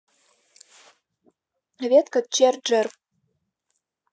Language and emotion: Russian, neutral